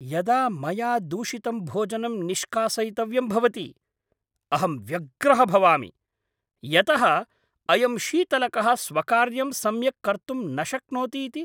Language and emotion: Sanskrit, angry